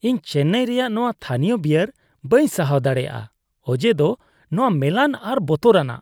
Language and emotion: Santali, disgusted